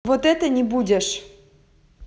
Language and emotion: Russian, angry